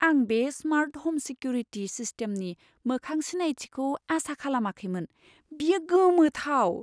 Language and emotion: Bodo, surprised